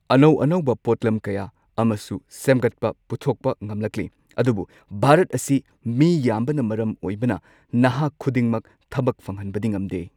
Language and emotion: Manipuri, neutral